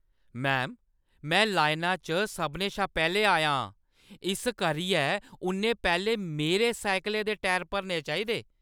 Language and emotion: Dogri, angry